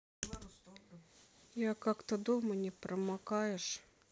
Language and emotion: Russian, neutral